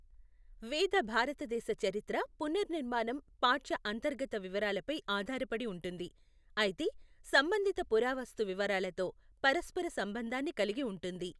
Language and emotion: Telugu, neutral